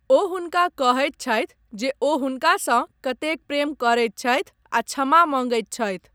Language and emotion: Maithili, neutral